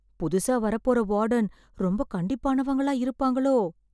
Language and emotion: Tamil, fearful